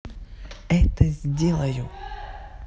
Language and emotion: Russian, neutral